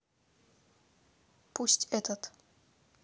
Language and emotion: Russian, neutral